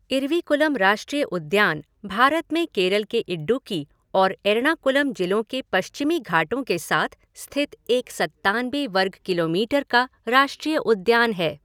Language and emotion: Hindi, neutral